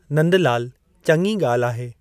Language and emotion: Sindhi, neutral